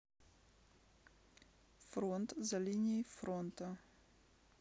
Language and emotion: Russian, neutral